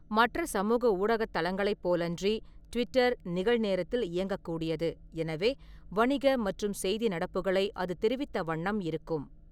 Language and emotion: Tamil, neutral